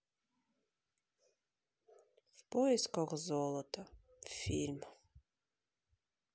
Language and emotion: Russian, sad